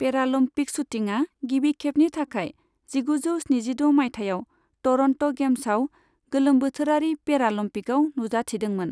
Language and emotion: Bodo, neutral